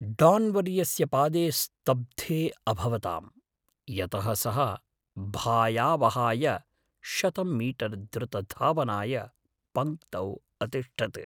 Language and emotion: Sanskrit, fearful